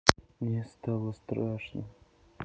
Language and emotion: Russian, sad